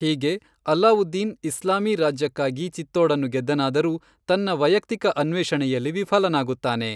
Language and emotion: Kannada, neutral